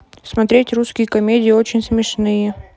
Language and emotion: Russian, neutral